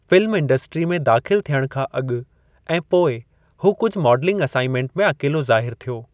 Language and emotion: Sindhi, neutral